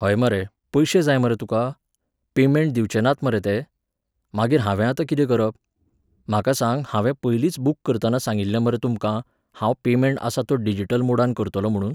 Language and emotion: Goan Konkani, neutral